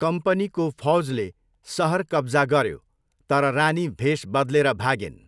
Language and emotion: Nepali, neutral